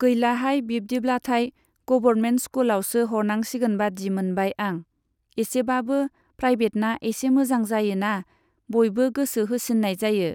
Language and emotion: Bodo, neutral